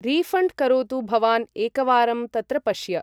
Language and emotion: Sanskrit, neutral